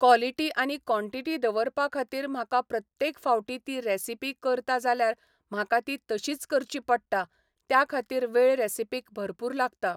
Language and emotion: Goan Konkani, neutral